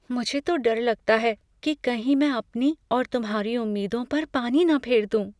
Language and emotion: Hindi, fearful